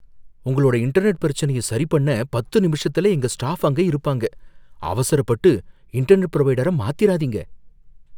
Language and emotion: Tamil, fearful